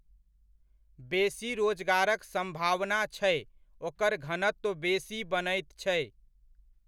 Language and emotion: Maithili, neutral